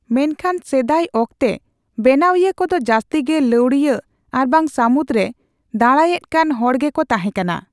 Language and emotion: Santali, neutral